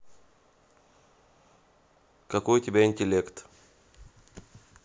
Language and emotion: Russian, neutral